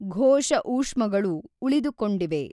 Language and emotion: Kannada, neutral